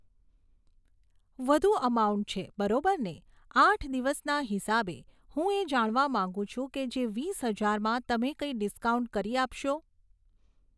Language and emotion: Gujarati, neutral